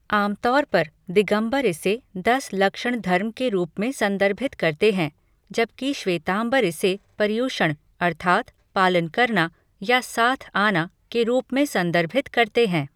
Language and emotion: Hindi, neutral